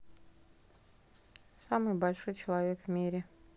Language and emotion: Russian, neutral